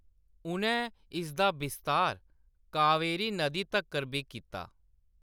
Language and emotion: Dogri, neutral